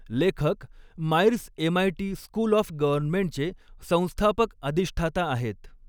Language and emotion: Marathi, neutral